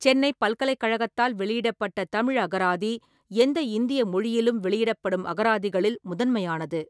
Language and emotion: Tamil, neutral